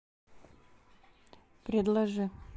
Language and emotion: Russian, neutral